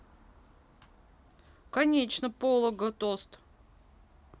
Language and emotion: Russian, neutral